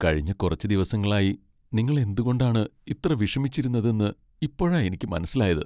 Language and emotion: Malayalam, sad